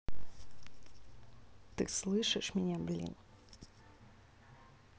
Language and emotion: Russian, angry